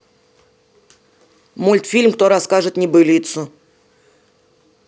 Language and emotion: Russian, neutral